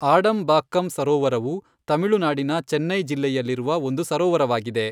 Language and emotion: Kannada, neutral